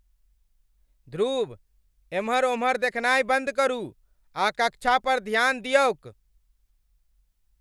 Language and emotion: Maithili, angry